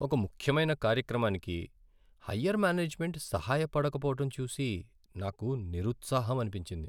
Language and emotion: Telugu, sad